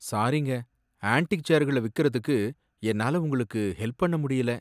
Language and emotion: Tamil, sad